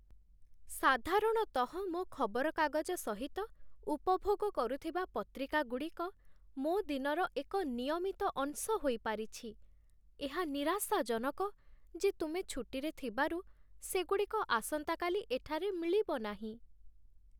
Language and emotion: Odia, sad